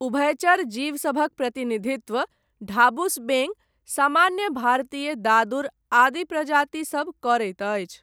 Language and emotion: Maithili, neutral